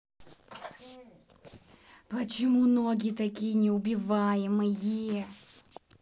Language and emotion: Russian, angry